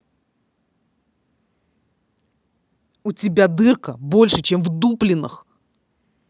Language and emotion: Russian, angry